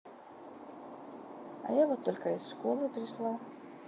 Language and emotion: Russian, neutral